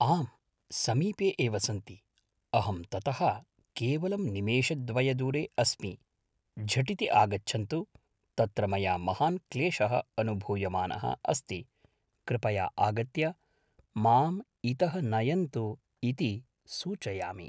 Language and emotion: Sanskrit, neutral